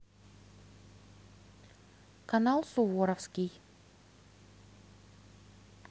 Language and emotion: Russian, neutral